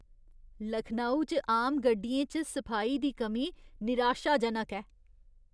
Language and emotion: Dogri, disgusted